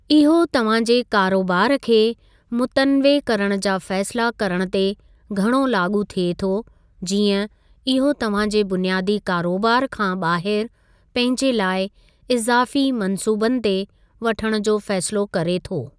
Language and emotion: Sindhi, neutral